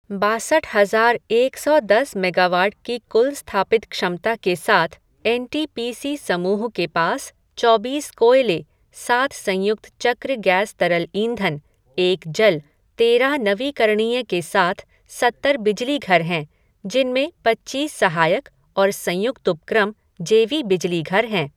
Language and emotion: Hindi, neutral